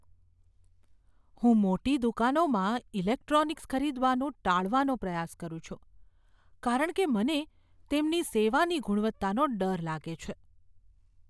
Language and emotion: Gujarati, fearful